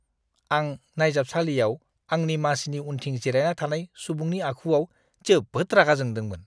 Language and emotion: Bodo, disgusted